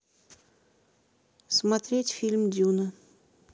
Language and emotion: Russian, neutral